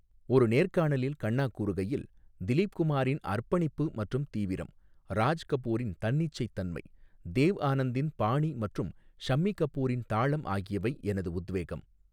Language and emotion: Tamil, neutral